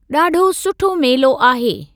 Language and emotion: Sindhi, neutral